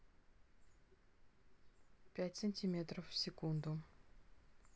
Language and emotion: Russian, neutral